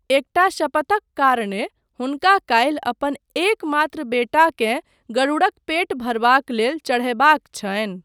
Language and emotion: Maithili, neutral